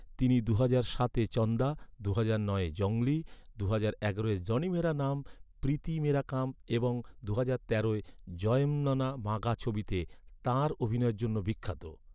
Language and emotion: Bengali, neutral